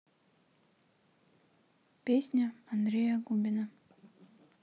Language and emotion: Russian, neutral